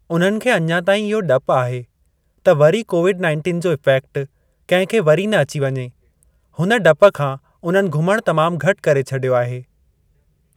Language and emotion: Sindhi, neutral